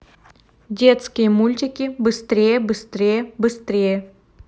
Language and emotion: Russian, neutral